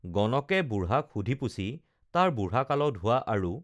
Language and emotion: Assamese, neutral